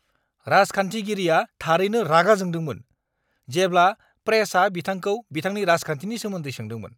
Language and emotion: Bodo, angry